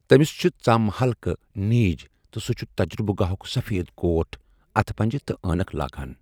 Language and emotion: Kashmiri, neutral